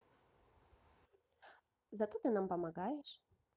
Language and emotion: Russian, positive